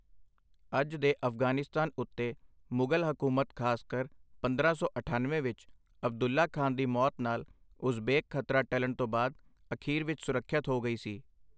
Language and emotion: Punjabi, neutral